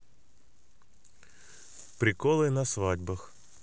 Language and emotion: Russian, neutral